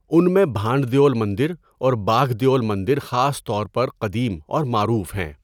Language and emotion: Urdu, neutral